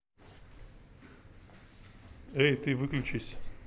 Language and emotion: Russian, neutral